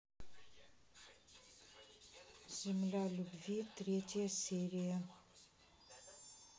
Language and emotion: Russian, neutral